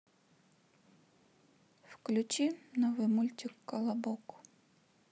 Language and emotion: Russian, sad